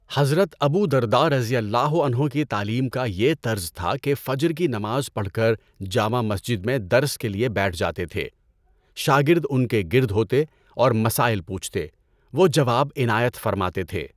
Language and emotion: Urdu, neutral